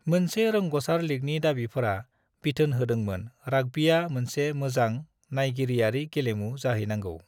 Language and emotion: Bodo, neutral